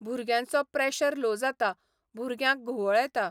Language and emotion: Goan Konkani, neutral